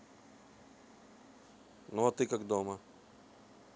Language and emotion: Russian, neutral